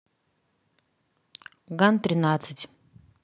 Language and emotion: Russian, neutral